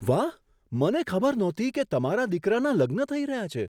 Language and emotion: Gujarati, surprised